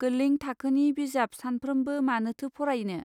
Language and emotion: Bodo, neutral